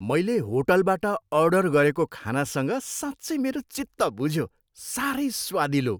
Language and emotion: Nepali, happy